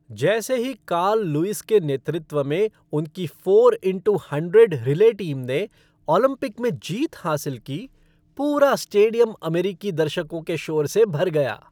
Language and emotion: Hindi, happy